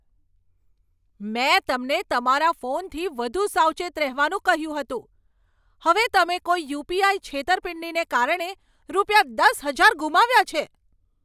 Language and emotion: Gujarati, angry